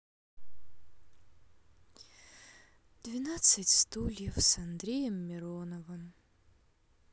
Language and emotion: Russian, sad